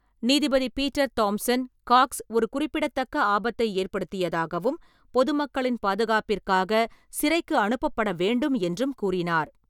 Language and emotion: Tamil, neutral